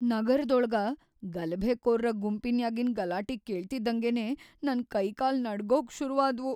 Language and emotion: Kannada, fearful